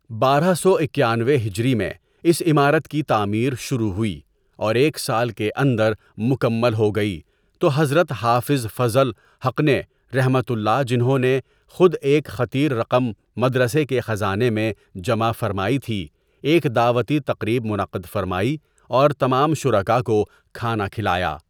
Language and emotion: Urdu, neutral